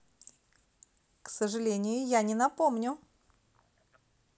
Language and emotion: Russian, positive